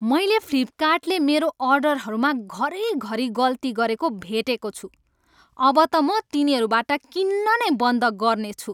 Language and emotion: Nepali, angry